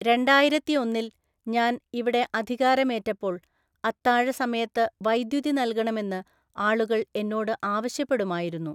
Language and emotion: Malayalam, neutral